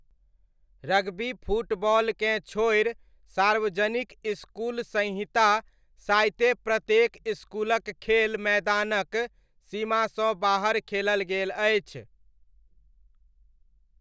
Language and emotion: Maithili, neutral